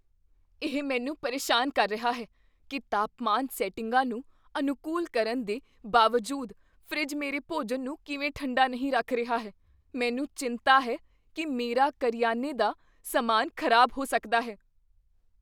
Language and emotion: Punjabi, fearful